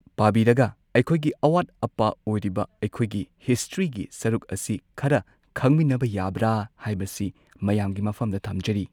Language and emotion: Manipuri, neutral